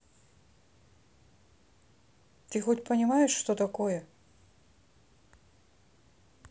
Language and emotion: Russian, neutral